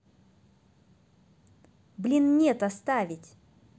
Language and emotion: Russian, angry